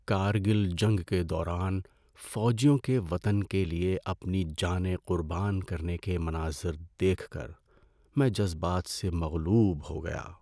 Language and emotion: Urdu, sad